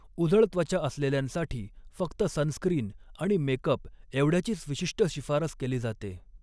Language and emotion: Marathi, neutral